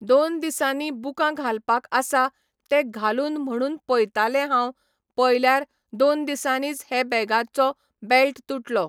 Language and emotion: Goan Konkani, neutral